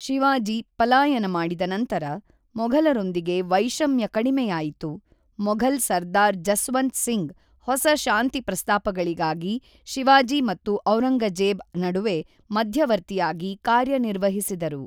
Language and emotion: Kannada, neutral